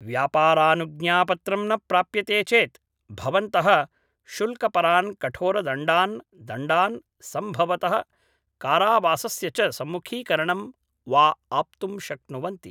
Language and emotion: Sanskrit, neutral